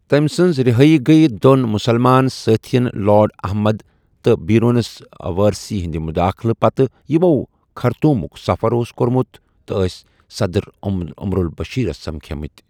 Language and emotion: Kashmiri, neutral